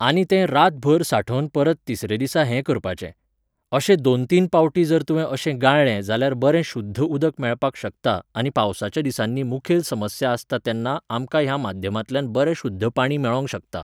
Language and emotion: Goan Konkani, neutral